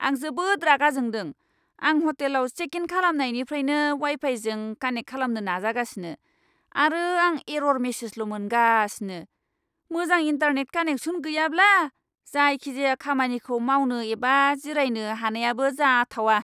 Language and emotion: Bodo, angry